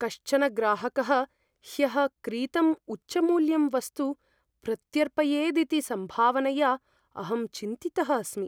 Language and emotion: Sanskrit, fearful